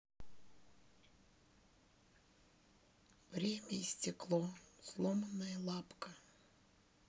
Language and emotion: Russian, sad